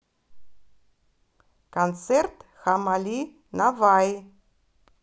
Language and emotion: Russian, neutral